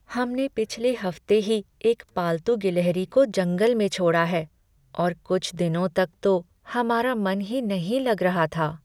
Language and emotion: Hindi, sad